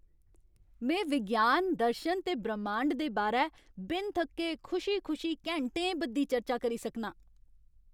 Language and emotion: Dogri, happy